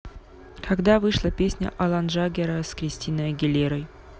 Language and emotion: Russian, neutral